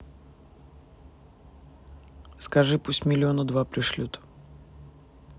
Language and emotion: Russian, neutral